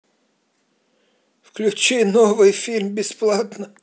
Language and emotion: Russian, sad